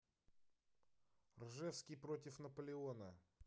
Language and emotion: Russian, neutral